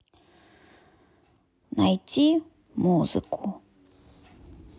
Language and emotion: Russian, sad